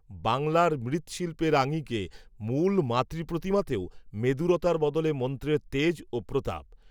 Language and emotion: Bengali, neutral